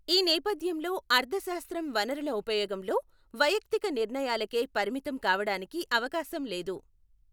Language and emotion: Telugu, neutral